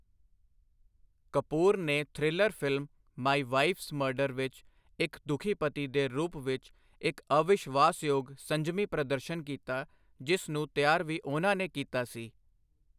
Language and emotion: Punjabi, neutral